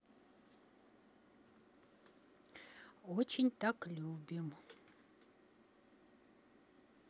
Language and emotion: Russian, neutral